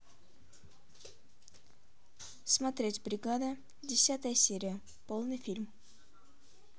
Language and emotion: Russian, neutral